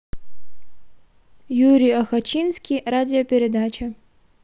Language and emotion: Russian, neutral